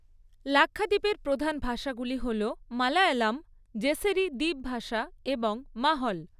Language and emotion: Bengali, neutral